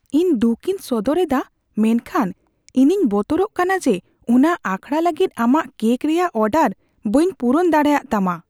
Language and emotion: Santali, fearful